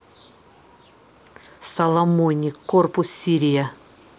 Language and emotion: Russian, neutral